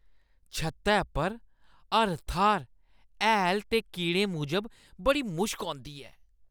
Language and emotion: Dogri, disgusted